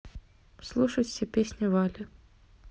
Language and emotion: Russian, neutral